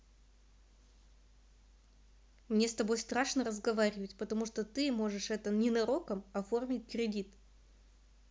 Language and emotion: Russian, neutral